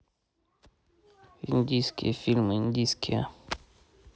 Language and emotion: Russian, neutral